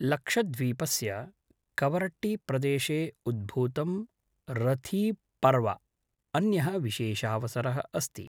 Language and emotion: Sanskrit, neutral